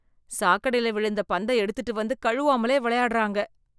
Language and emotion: Tamil, disgusted